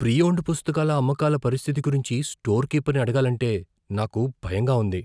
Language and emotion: Telugu, fearful